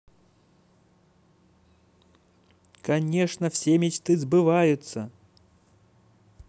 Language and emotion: Russian, positive